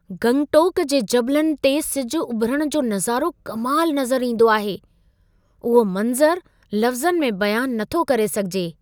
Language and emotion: Sindhi, surprised